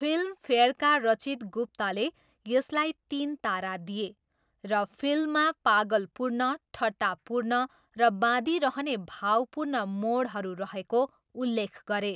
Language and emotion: Nepali, neutral